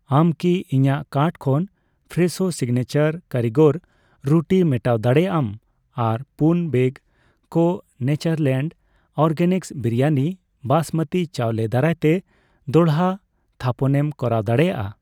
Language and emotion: Santali, neutral